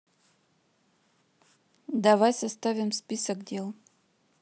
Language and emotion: Russian, neutral